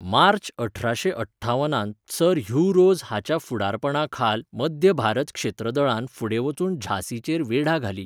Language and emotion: Goan Konkani, neutral